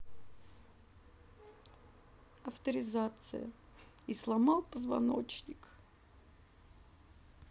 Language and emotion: Russian, sad